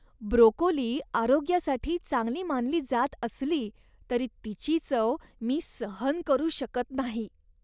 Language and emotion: Marathi, disgusted